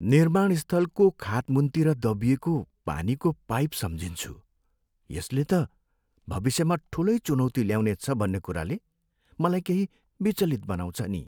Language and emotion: Nepali, sad